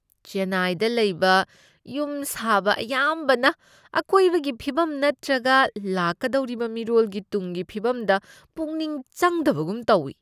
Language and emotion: Manipuri, disgusted